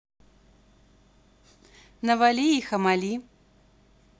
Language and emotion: Russian, positive